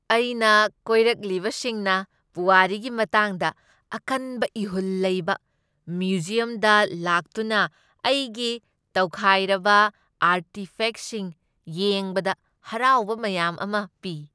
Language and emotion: Manipuri, happy